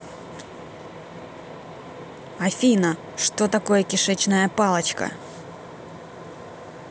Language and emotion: Russian, angry